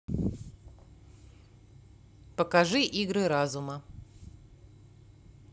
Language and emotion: Russian, neutral